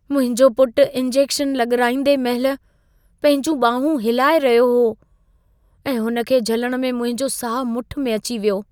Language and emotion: Sindhi, fearful